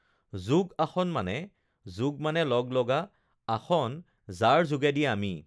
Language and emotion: Assamese, neutral